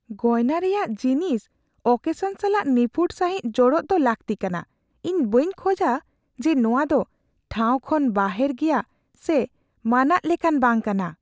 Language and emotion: Santali, fearful